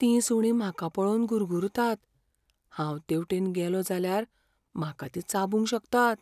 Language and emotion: Goan Konkani, fearful